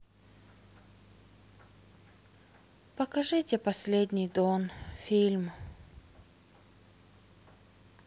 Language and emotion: Russian, sad